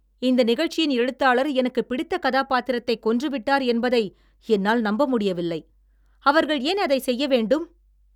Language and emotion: Tamil, angry